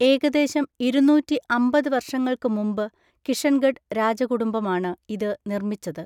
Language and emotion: Malayalam, neutral